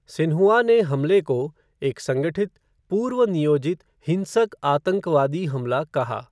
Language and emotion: Hindi, neutral